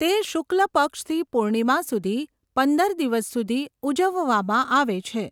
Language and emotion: Gujarati, neutral